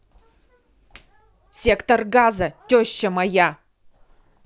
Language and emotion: Russian, angry